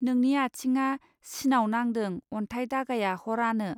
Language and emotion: Bodo, neutral